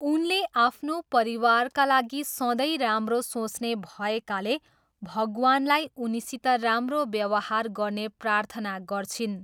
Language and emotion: Nepali, neutral